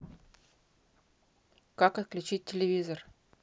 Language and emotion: Russian, neutral